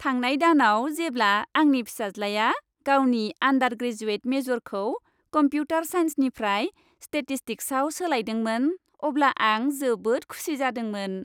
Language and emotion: Bodo, happy